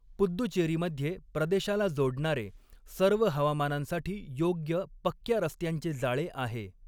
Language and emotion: Marathi, neutral